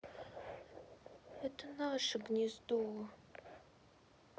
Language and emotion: Russian, sad